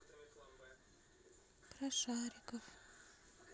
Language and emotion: Russian, sad